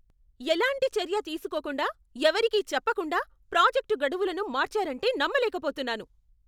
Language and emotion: Telugu, angry